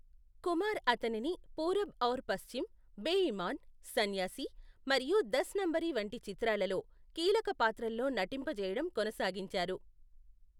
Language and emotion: Telugu, neutral